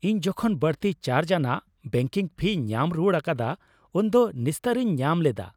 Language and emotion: Santali, happy